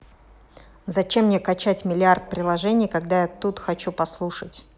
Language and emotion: Russian, angry